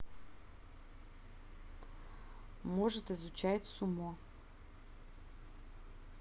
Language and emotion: Russian, neutral